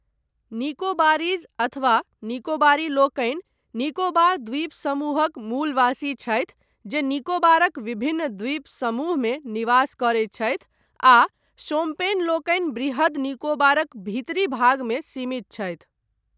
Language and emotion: Maithili, neutral